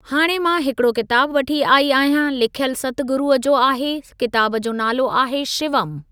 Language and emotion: Sindhi, neutral